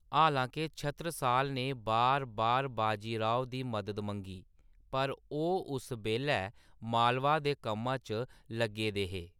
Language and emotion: Dogri, neutral